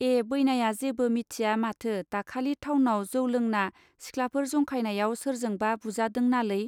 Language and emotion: Bodo, neutral